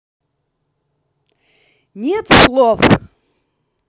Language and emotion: Russian, angry